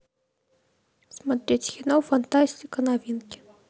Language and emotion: Russian, neutral